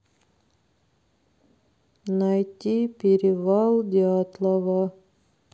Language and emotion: Russian, sad